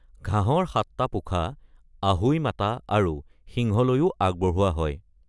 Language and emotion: Assamese, neutral